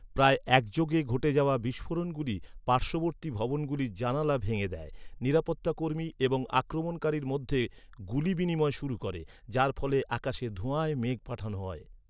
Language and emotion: Bengali, neutral